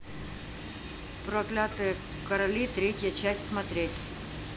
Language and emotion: Russian, neutral